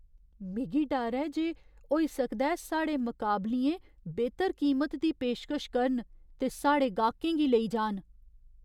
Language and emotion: Dogri, fearful